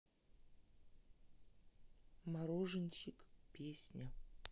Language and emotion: Russian, neutral